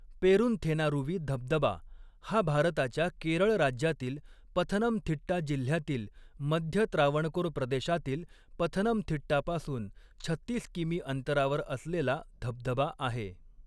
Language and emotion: Marathi, neutral